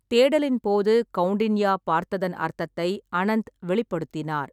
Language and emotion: Tamil, neutral